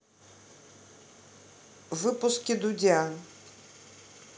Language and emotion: Russian, neutral